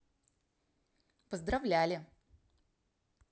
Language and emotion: Russian, positive